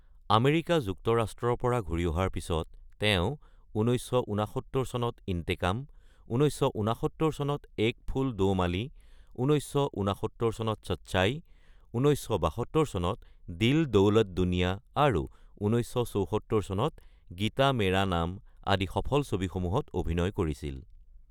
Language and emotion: Assamese, neutral